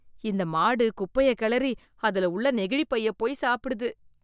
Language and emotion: Tamil, disgusted